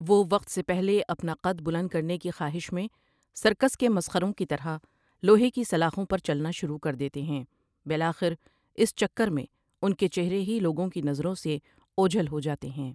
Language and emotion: Urdu, neutral